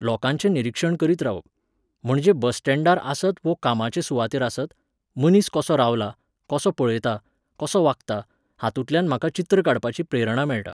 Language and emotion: Goan Konkani, neutral